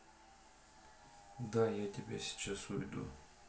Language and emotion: Russian, sad